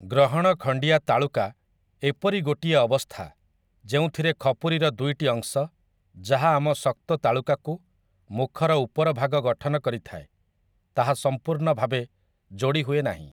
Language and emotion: Odia, neutral